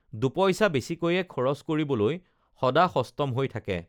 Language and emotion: Assamese, neutral